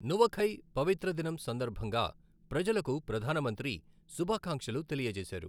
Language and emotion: Telugu, neutral